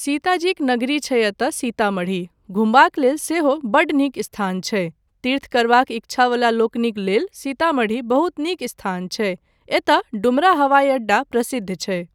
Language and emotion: Maithili, neutral